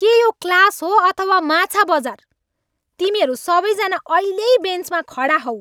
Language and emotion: Nepali, angry